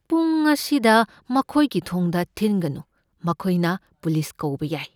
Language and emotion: Manipuri, fearful